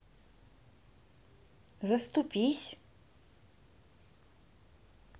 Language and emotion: Russian, neutral